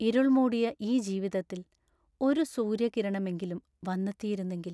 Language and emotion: Malayalam, sad